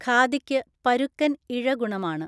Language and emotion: Malayalam, neutral